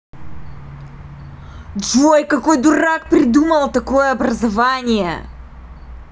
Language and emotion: Russian, angry